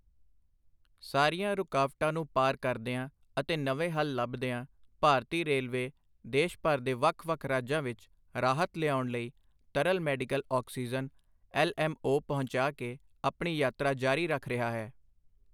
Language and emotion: Punjabi, neutral